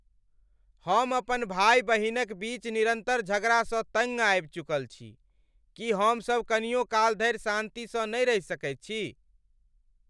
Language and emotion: Maithili, angry